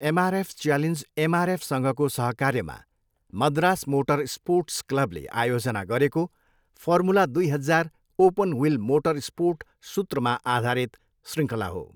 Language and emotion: Nepali, neutral